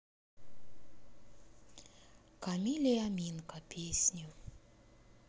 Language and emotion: Russian, sad